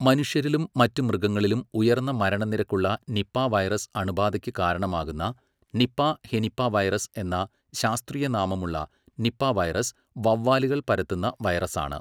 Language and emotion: Malayalam, neutral